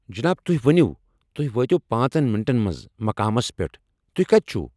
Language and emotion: Kashmiri, angry